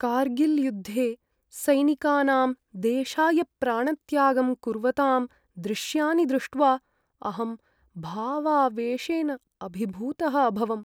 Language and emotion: Sanskrit, sad